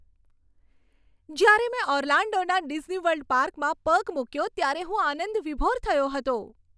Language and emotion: Gujarati, happy